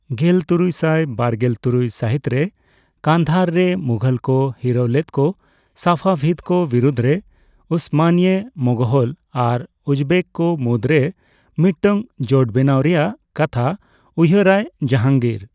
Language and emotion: Santali, neutral